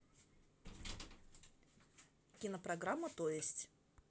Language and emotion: Russian, neutral